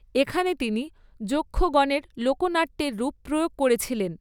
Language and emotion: Bengali, neutral